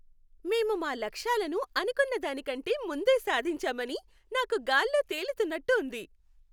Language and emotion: Telugu, happy